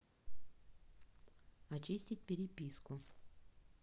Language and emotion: Russian, neutral